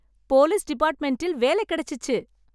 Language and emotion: Tamil, happy